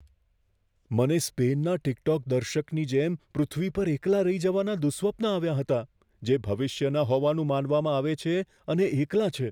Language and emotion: Gujarati, fearful